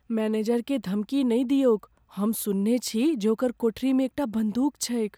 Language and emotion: Maithili, fearful